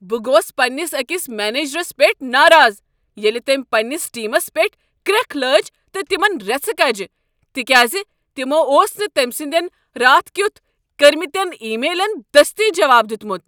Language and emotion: Kashmiri, angry